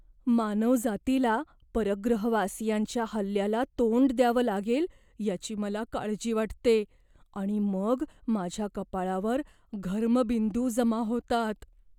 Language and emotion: Marathi, fearful